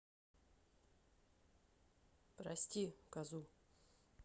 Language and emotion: Russian, neutral